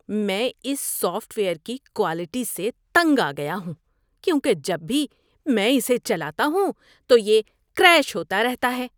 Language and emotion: Urdu, disgusted